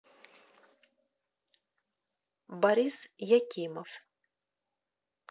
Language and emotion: Russian, neutral